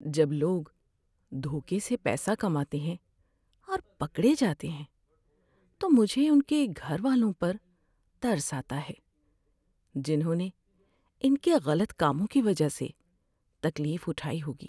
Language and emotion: Urdu, sad